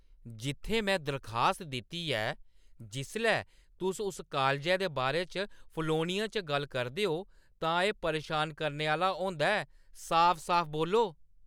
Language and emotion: Dogri, angry